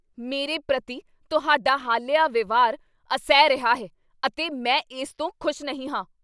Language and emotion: Punjabi, angry